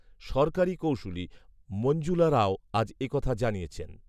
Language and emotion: Bengali, neutral